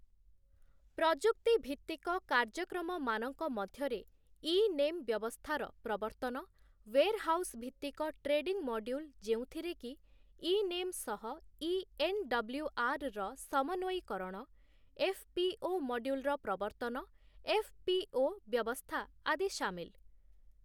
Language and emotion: Odia, neutral